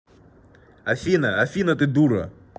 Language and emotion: Russian, angry